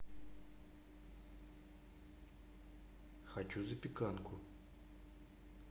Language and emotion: Russian, neutral